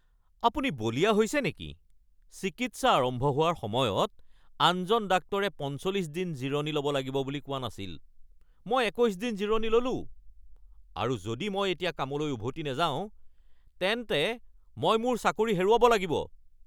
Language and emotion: Assamese, angry